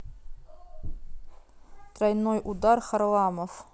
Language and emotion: Russian, neutral